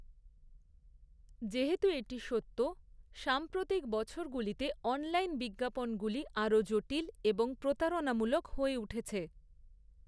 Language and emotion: Bengali, neutral